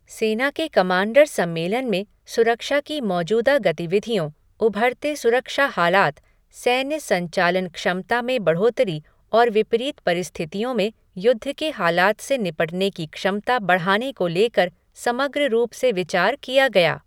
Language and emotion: Hindi, neutral